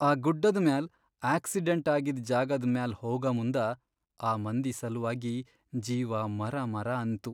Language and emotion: Kannada, sad